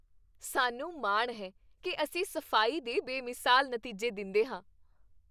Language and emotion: Punjabi, happy